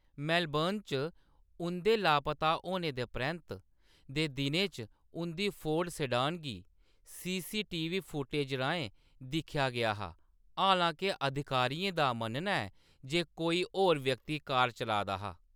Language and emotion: Dogri, neutral